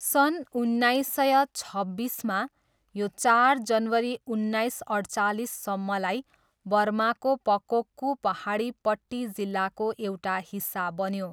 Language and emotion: Nepali, neutral